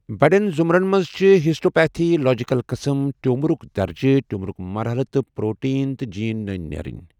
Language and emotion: Kashmiri, neutral